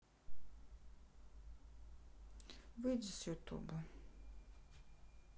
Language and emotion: Russian, sad